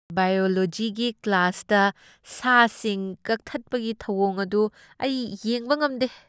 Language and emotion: Manipuri, disgusted